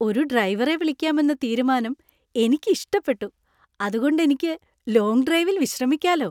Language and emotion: Malayalam, happy